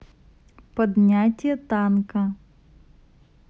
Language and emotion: Russian, neutral